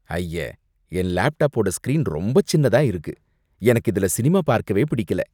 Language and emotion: Tamil, disgusted